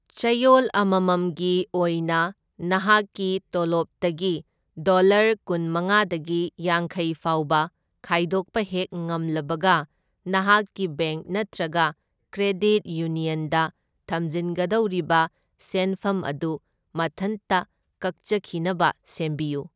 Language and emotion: Manipuri, neutral